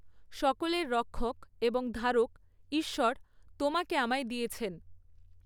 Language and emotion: Bengali, neutral